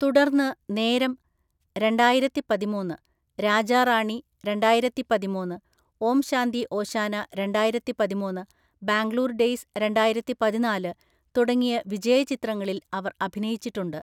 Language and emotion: Malayalam, neutral